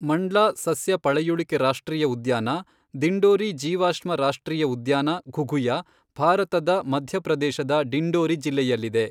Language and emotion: Kannada, neutral